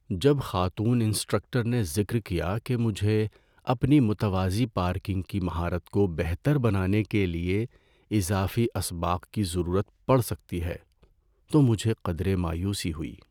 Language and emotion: Urdu, sad